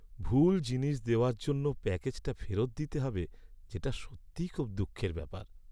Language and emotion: Bengali, sad